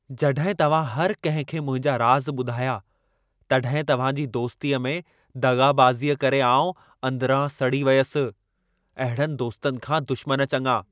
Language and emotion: Sindhi, angry